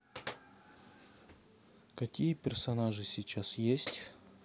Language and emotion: Russian, neutral